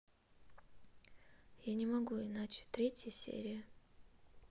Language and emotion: Russian, sad